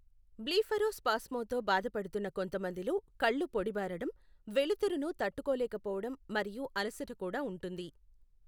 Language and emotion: Telugu, neutral